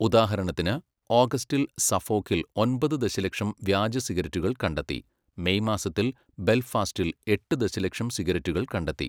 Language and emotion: Malayalam, neutral